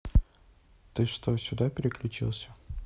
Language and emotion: Russian, neutral